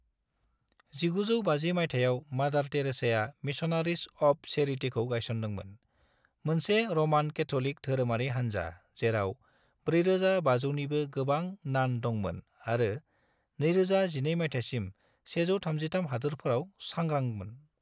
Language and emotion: Bodo, neutral